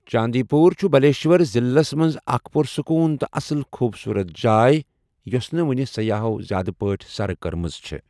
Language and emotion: Kashmiri, neutral